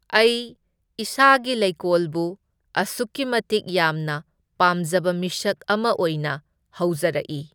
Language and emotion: Manipuri, neutral